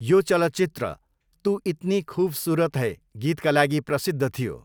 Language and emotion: Nepali, neutral